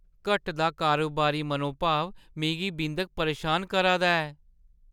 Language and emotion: Dogri, fearful